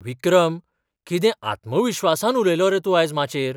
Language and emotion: Goan Konkani, surprised